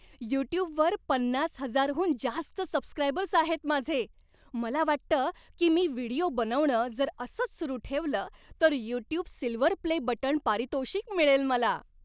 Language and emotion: Marathi, happy